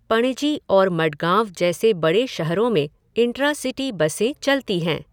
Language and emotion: Hindi, neutral